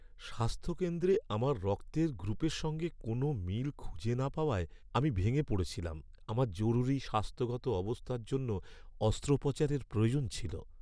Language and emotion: Bengali, sad